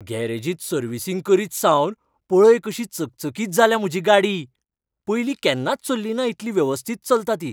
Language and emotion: Goan Konkani, happy